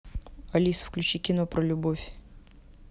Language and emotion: Russian, neutral